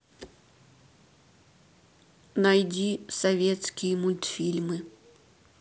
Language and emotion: Russian, neutral